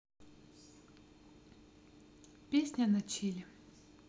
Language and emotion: Russian, neutral